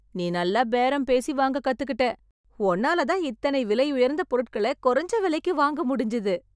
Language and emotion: Tamil, happy